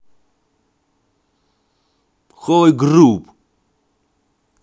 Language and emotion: Russian, angry